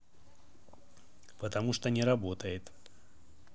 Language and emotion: Russian, neutral